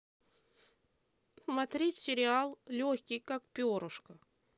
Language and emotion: Russian, neutral